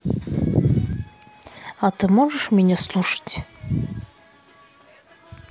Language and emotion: Russian, neutral